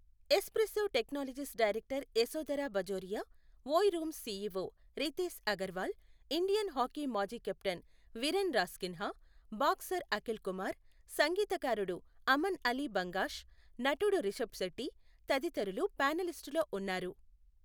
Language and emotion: Telugu, neutral